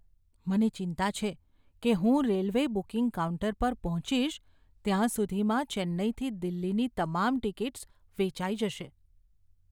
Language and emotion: Gujarati, fearful